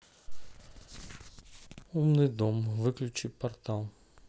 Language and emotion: Russian, neutral